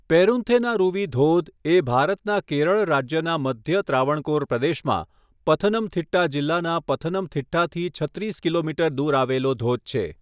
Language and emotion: Gujarati, neutral